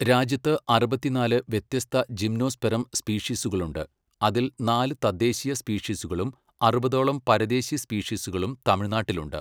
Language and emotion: Malayalam, neutral